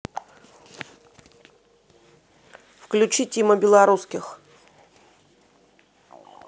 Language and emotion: Russian, neutral